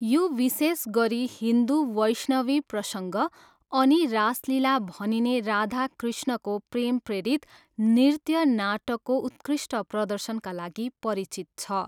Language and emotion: Nepali, neutral